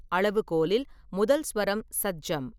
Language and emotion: Tamil, neutral